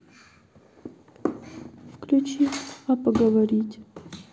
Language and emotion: Russian, sad